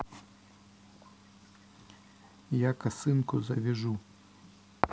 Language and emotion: Russian, neutral